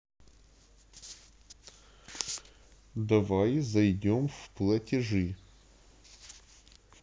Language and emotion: Russian, neutral